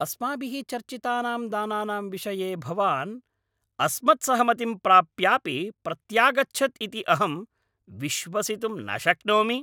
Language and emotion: Sanskrit, angry